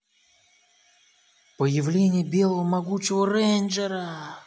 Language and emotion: Russian, positive